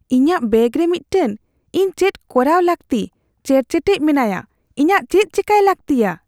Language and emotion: Santali, fearful